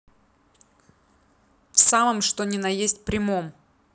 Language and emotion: Russian, angry